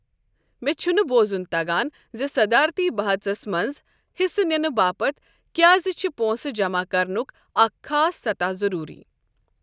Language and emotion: Kashmiri, neutral